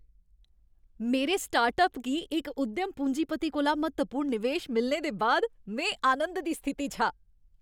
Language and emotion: Dogri, happy